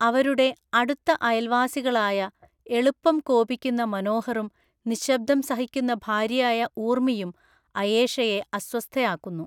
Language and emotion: Malayalam, neutral